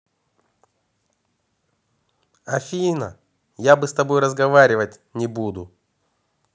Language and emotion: Russian, angry